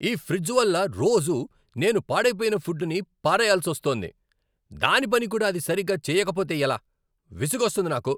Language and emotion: Telugu, angry